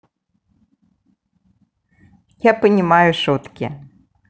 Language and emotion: Russian, positive